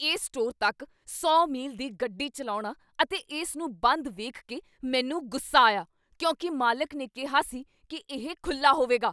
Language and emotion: Punjabi, angry